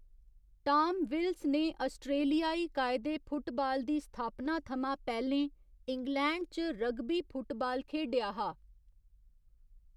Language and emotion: Dogri, neutral